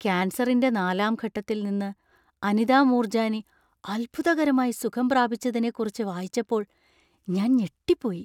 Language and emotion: Malayalam, surprised